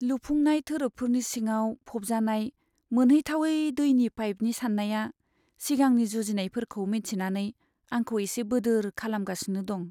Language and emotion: Bodo, sad